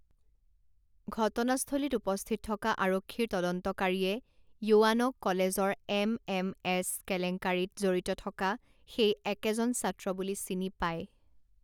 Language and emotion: Assamese, neutral